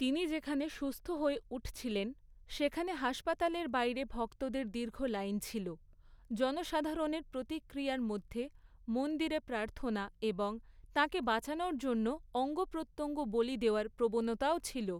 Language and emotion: Bengali, neutral